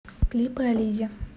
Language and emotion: Russian, neutral